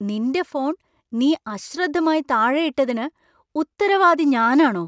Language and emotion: Malayalam, surprised